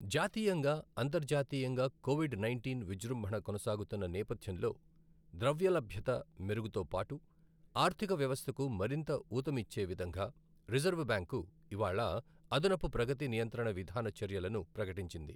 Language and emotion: Telugu, neutral